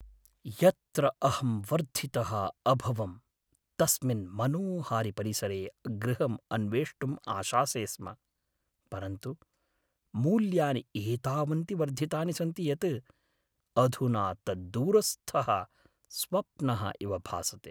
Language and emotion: Sanskrit, sad